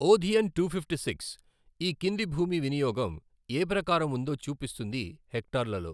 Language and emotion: Telugu, neutral